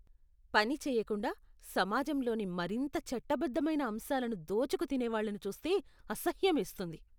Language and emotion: Telugu, disgusted